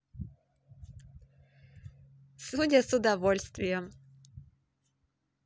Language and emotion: Russian, positive